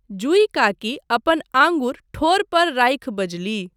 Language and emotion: Maithili, neutral